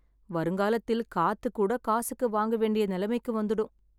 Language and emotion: Tamil, sad